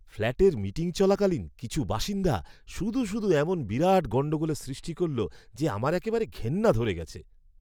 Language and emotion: Bengali, disgusted